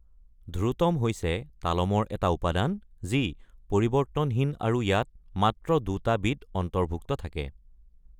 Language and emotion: Assamese, neutral